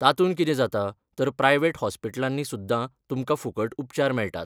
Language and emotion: Goan Konkani, neutral